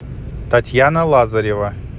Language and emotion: Russian, neutral